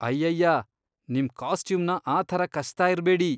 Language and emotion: Kannada, disgusted